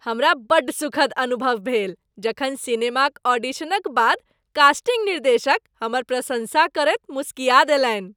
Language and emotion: Maithili, happy